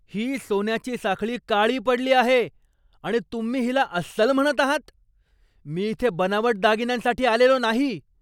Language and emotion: Marathi, angry